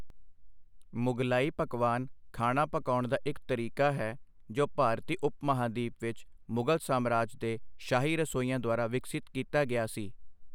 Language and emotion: Punjabi, neutral